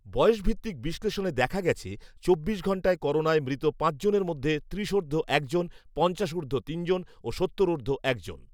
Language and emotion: Bengali, neutral